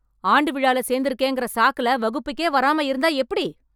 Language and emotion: Tamil, angry